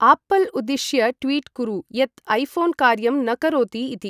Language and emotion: Sanskrit, neutral